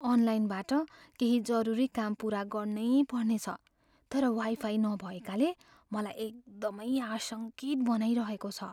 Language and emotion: Nepali, fearful